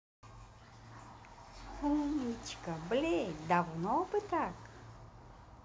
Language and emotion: Russian, positive